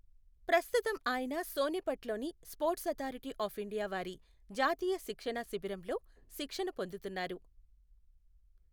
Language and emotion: Telugu, neutral